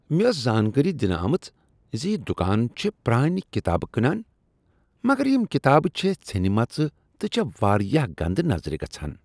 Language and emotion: Kashmiri, disgusted